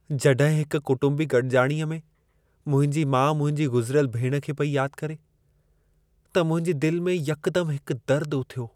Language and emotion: Sindhi, sad